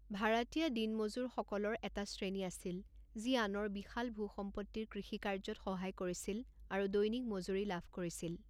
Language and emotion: Assamese, neutral